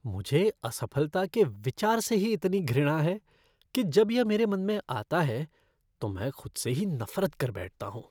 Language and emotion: Hindi, disgusted